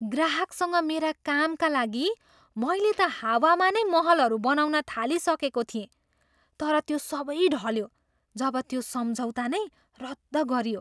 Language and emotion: Nepali, surprised